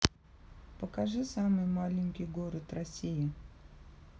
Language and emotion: Russian, neutral